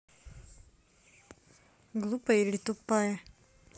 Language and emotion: Russian, angry